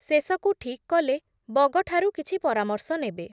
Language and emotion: Odia, neutral